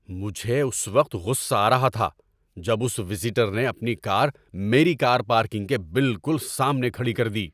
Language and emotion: Urdu, angry